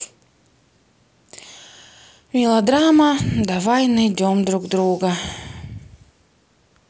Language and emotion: Russian, sad